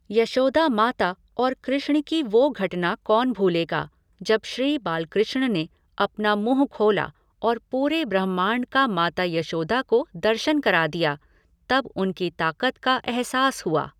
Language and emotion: Hindi, neutral